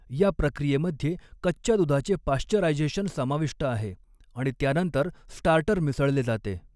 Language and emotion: Marathi, neutral